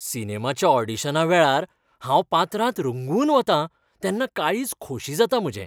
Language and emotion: Goan Konkani, happy